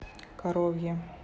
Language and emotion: Russian, neutral